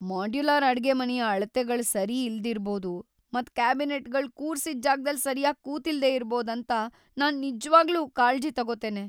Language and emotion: Kannada, fearful